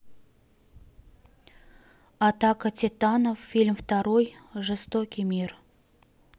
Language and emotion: Russian, neutral